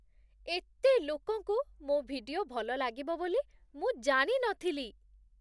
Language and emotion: Odia, surprised